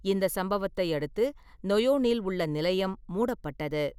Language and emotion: Tamil, neutral